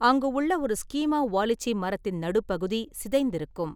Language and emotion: Tamil, neutral